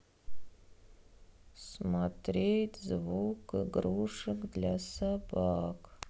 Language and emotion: Russian, sad